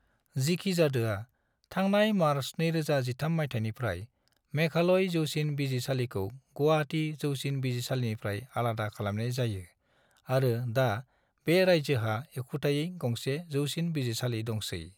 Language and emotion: Bodo, neutral